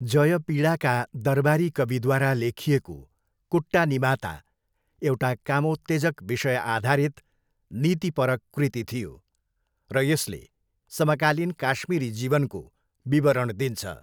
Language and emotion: Nepali, neutral